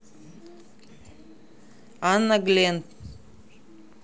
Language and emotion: Russian, neutral